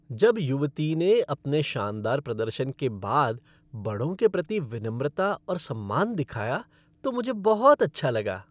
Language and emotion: Hindi, happy